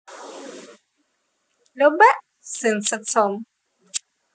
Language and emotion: Russian, positive